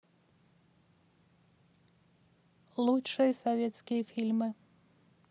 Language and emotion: Russian, neutral